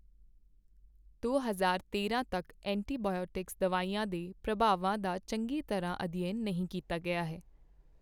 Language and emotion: Punjabi, neutral